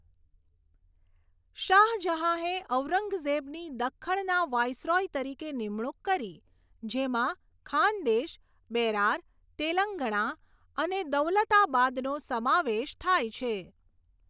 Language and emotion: Gujarati, neutral